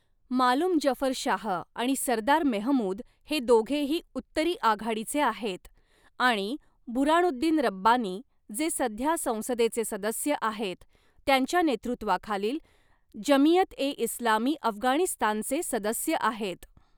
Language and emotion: Marathi, neutral